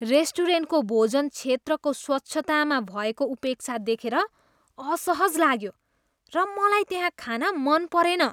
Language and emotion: Nepali, disgusted